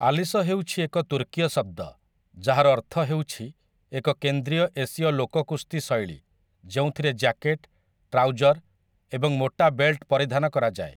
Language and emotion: Odia, neutral